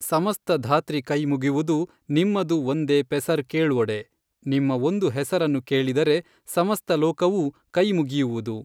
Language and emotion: Kannada, neutral